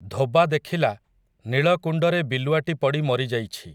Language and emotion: Odia, neutral